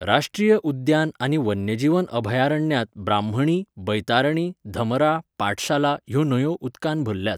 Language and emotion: Goan Konkani, neutral